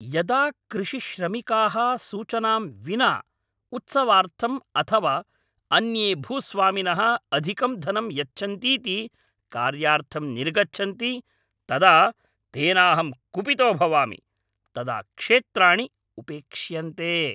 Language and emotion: Sanskrit, angry